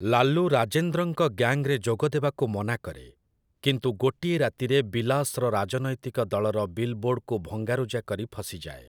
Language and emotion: Odia, neutral